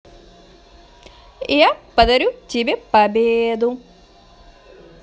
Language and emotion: Russian, positive